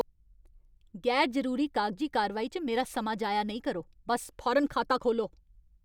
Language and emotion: Dogri, angry